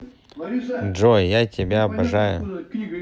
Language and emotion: Russian, neutral